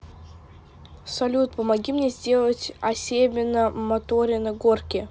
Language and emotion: Russian, neutral